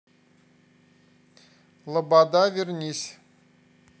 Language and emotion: Russian, neutral